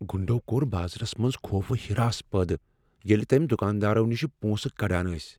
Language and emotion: Kashmiri, fearful